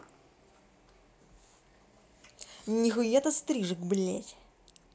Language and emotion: Russian, angry